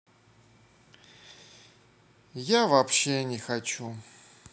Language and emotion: Russian, sad